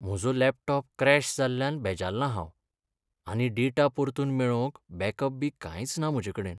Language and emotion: Goan Konkani, sad